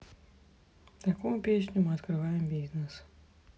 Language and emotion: Russian, sad